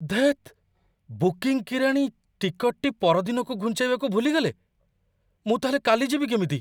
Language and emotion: Odia, surprised